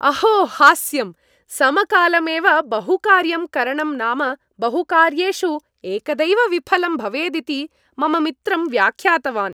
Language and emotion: Sanskrit, happy